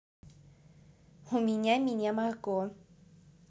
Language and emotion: Russian, neutral